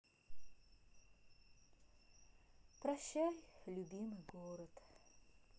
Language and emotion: Russian, sad